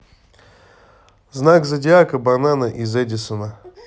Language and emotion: Russian, neutral